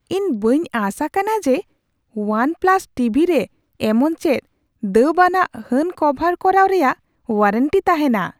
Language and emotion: Santali, surprised